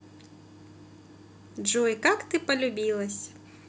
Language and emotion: Russian, positive